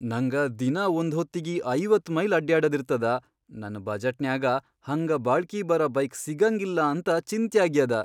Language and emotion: Kannada, fearful